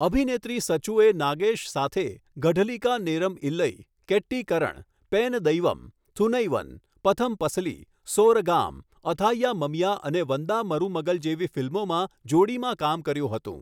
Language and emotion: Gujarati, neutral